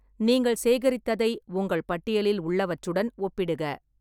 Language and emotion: Tamil, neutral